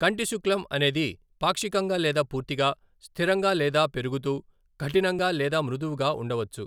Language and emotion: Telugu, neutral